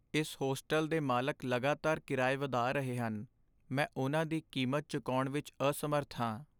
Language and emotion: Punjabi, sad